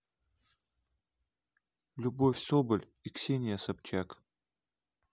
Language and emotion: Russian, neutral